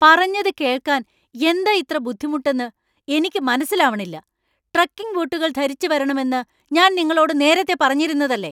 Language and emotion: Malayalam, angry